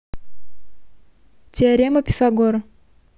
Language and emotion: Russian, neutral